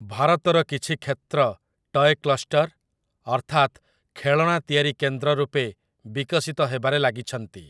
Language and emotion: Odia, neutral